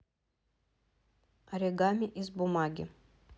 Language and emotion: Russian, neutral